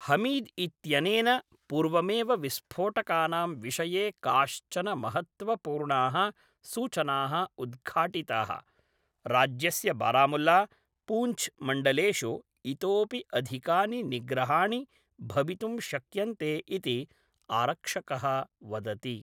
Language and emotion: Sanskrit, neutral